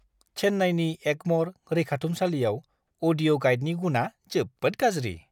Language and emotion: Bodo, disgusted